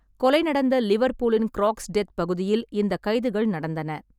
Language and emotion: Tamil, neutral